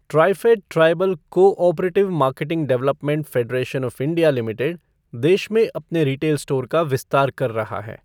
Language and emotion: Hindi, neutral